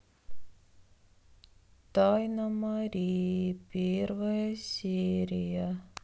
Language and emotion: Russian, sad